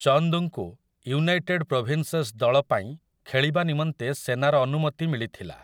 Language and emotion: Odia, neutral